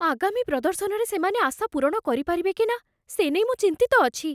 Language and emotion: Odia, fearful